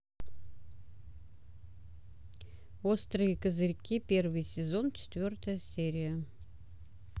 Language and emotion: Russian, neutral